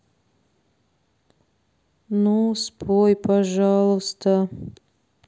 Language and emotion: Russian, sad